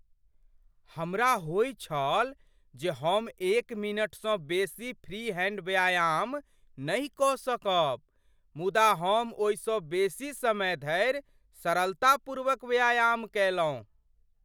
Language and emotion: Maithili, surprised